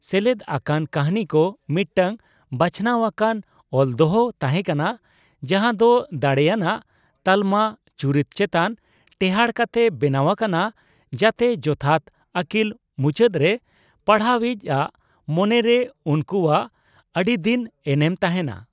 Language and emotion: Santali, neutral